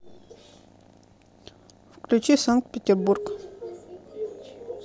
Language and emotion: Russian, neutral